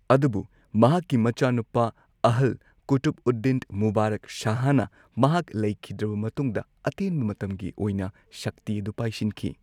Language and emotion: Manipuri, neutral